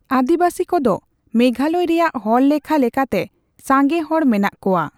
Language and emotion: Santali, neutral